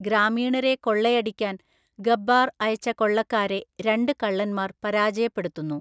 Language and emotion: Malayalam, neutral